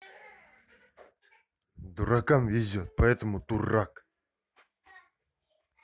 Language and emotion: Russian, angry